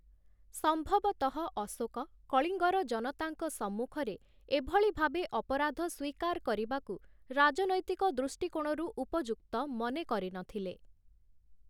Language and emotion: Odia, neutral